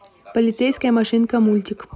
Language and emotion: Russian, neutral